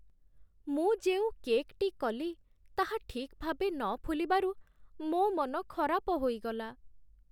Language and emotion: Odia, sad